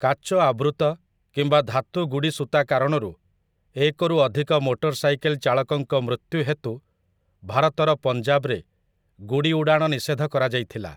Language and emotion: Odia, neutral